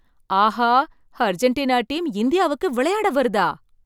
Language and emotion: Tamil, surprised